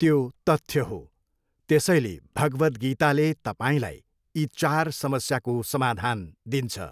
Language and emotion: Nepali, neutral